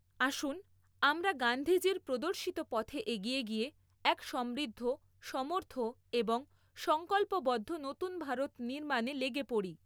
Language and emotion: Bengali, neutral